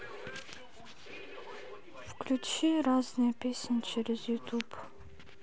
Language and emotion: Russian, sad